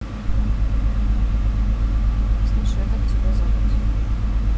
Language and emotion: Russian, neutral